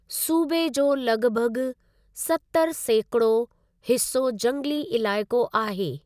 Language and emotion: Sindhi, neutral